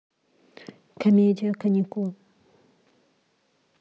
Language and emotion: Russian, neutral